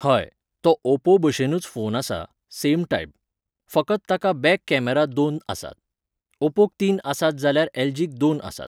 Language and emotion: Goan Konkani, neutral